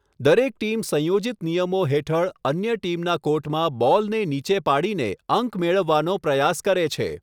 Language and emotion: Gujarati, neutral